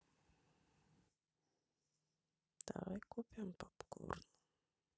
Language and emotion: Russian, sad